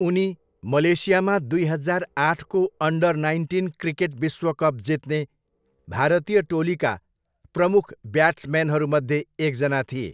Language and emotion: Nepali, neutral